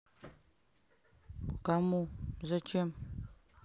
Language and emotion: Russian, neutral